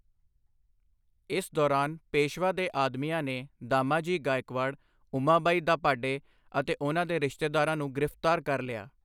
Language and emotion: Punjabi, neutral